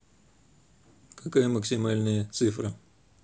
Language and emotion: Russian, neutral